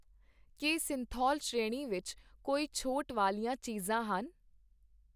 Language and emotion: Punjabi, neutral